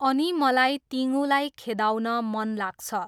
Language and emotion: Nepali, neutral